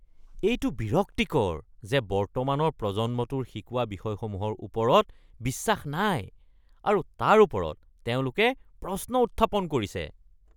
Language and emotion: Assamese, disgusted